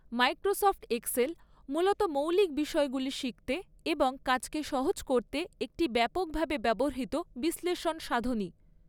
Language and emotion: Bengali, neutral